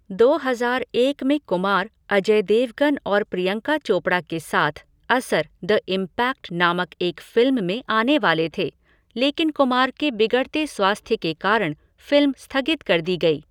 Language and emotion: Hindi, neutral